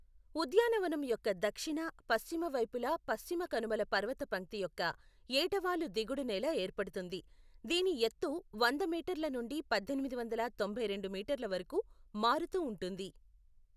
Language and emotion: Telugu, neutral